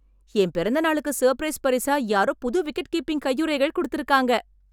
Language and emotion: Tamil, happy